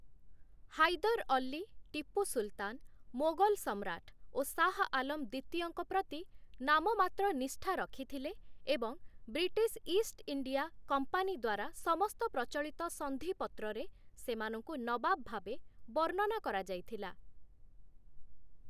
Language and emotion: Odia, neutral